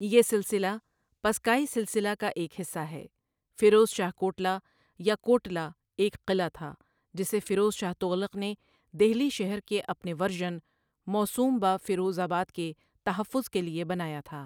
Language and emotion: Urdu, neutral